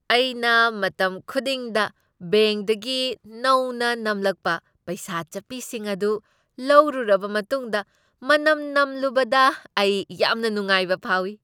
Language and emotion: Manipuri, happy